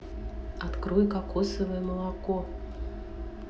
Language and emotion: Russian, neutral